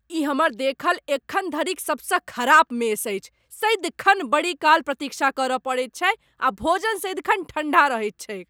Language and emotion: Maithili, angry